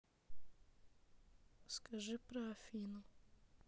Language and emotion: Russian, neutral